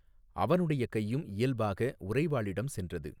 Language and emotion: Tamil, neutral